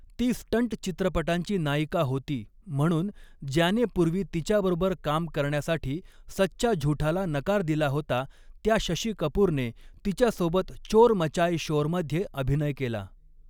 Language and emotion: Marathi, neutral